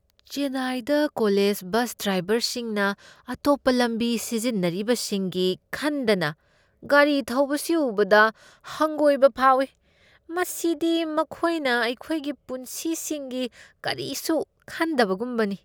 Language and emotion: Manipuri, disgusted